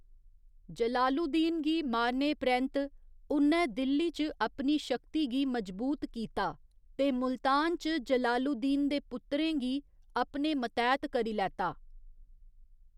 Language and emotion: Dogri, neutral